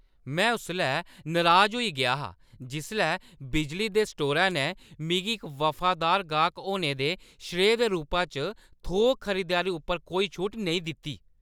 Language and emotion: Dogri, angry